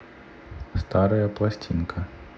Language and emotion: Russian, neutral